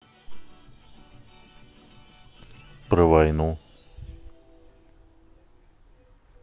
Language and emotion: Russian, neutral